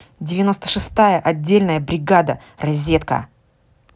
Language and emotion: Russian, angry